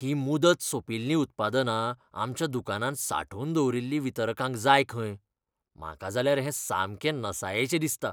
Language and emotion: Goan Konkani, disgusted